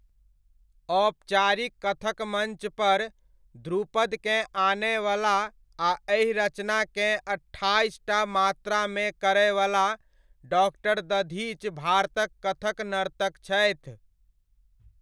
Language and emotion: Maithili, neutral